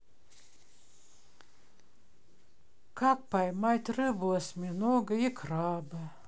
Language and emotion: Russian, sad